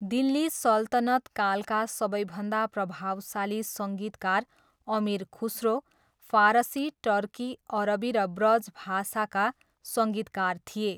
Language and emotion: Nepali, neutral